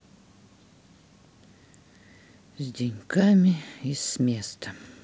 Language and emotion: Russian, sad